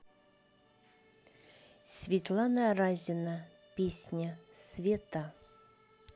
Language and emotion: Russian, neutral